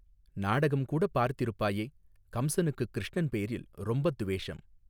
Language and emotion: Tamil, neutral